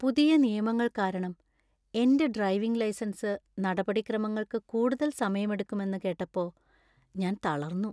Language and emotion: Malayalam, sad